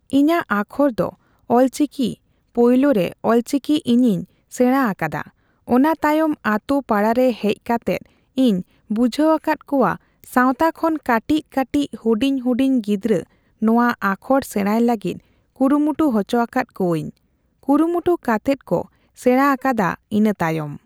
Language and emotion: Santali, neutral